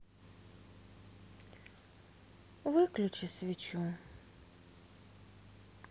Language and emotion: Russian, sad